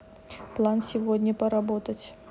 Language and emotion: Russian, neutral